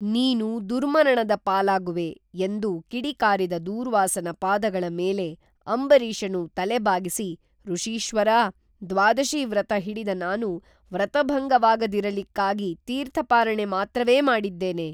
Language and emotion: Kannada, neutral